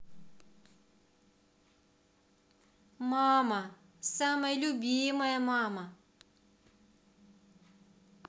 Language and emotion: Russian, positive